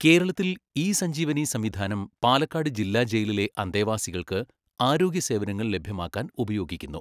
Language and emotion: Malayalam, neutral